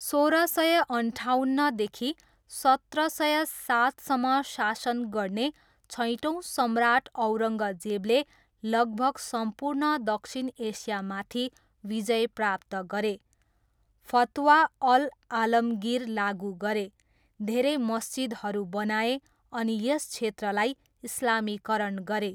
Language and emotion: Nepali, neutral